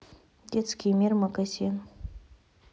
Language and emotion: Russian, neutral